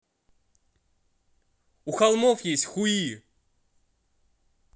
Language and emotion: Russian, angry